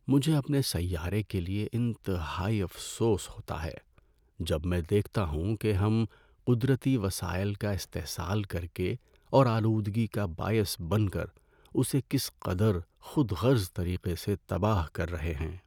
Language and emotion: Urdu, sad